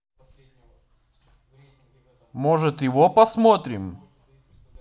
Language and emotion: Russian, positive